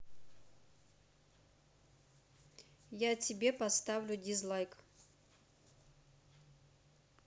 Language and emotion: Russian, neutral